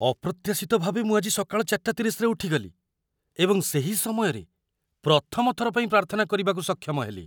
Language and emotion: Odia, surprised